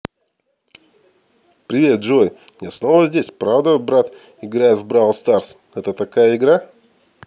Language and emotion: Russian, positive